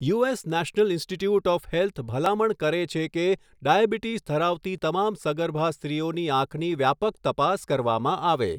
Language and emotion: Gujarati, neutral